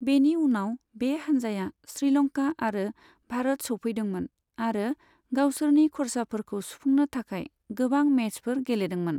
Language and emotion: Bodo, neutral